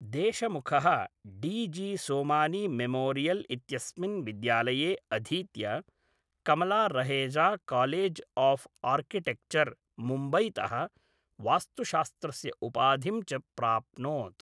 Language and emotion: Sanskrit, neutral